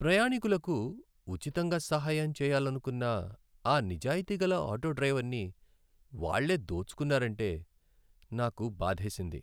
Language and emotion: Telugu, sad